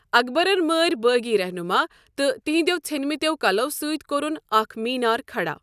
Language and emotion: Kashmiri, neutral